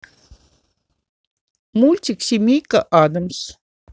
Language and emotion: Russian, neutral